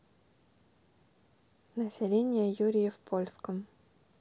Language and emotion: Russian, neutral